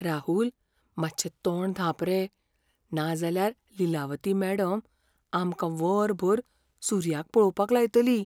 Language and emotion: Goan Konkani, fearful